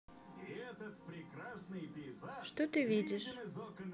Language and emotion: Russian, neutral